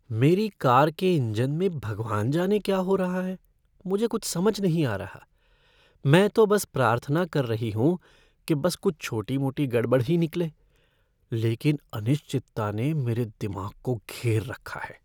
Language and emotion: Hindi, fearful